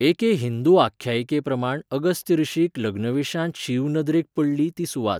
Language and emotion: Goan Konkani, neutral